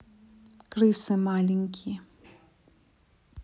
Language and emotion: Russian, neutral